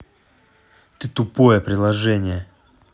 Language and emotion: Russian, angry